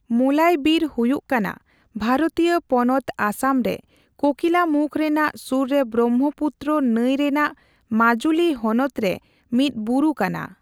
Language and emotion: Santali, neutral